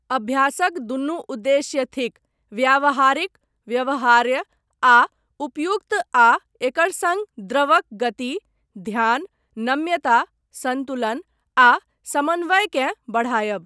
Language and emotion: Maithili, neutral